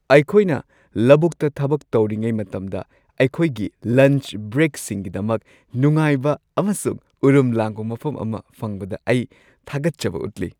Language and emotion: Manipuri, happy